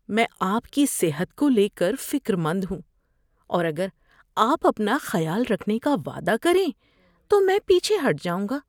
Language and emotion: Urdu, fearful